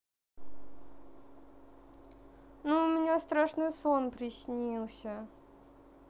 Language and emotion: Russian, sad